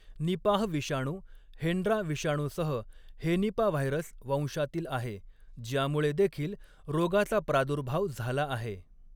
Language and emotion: Marathi, neutral